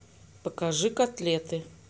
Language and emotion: Russian, neutral